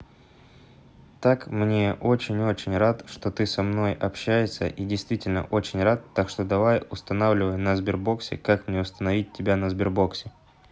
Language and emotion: Russian, neutral